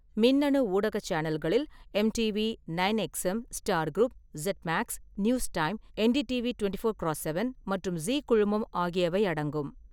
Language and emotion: Tamil, neutral